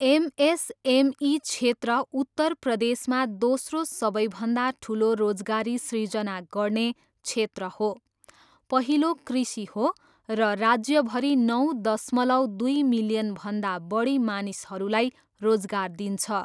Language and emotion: Nepali, neutral